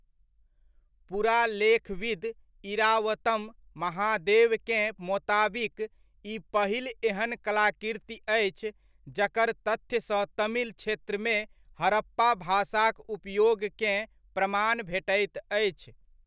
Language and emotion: Maithili, neutral